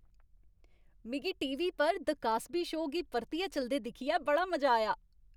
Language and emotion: Dogri, happy